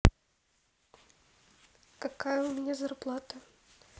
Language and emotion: Russian, neutral